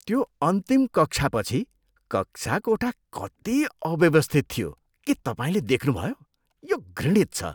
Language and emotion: Nepali, disgusted